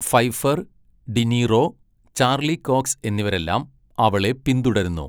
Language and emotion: Malayalam, neutral